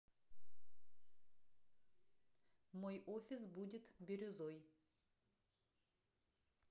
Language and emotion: Russian, neutral